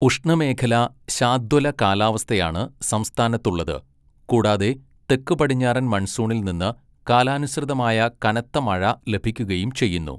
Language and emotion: Malayalam, neutral